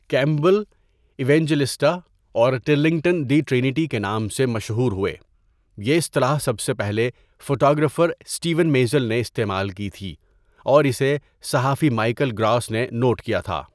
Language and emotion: Urdu, neutral